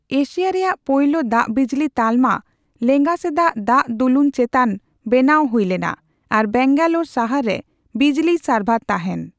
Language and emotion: Santali, neutral